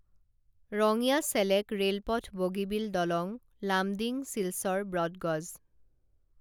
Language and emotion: Assamese, neutral